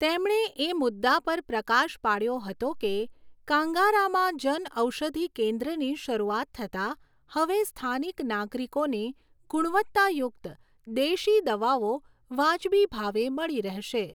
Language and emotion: Gujarati, neutral